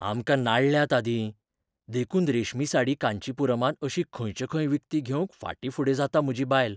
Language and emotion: Goan Konkani, fearful